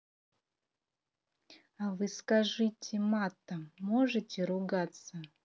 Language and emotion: Russian, neutral